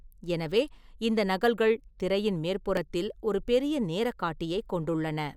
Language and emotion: Tamil, neutral